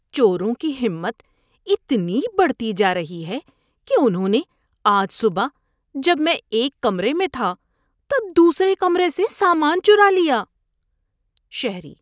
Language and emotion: Urdu, disgusted